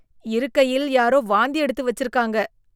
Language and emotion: Tamil, disgusted